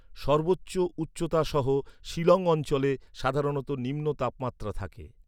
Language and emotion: Bengali, neutral